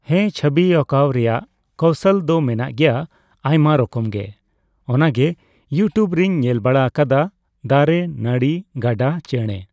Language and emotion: Santali, neutral